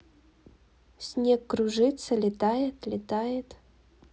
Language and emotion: Russian, neutral